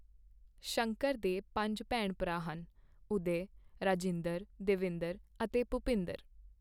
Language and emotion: Punjabi, neutral